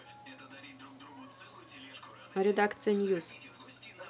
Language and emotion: Russian, neutral